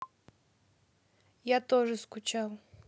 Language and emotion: Russian, neutral